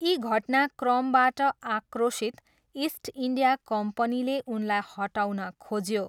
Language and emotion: Nepali, neutral